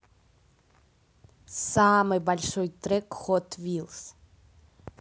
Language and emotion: Russian, positive